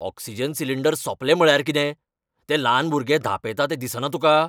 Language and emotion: Goan Konkani, angry